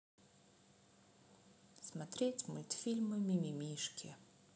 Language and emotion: Russian, sad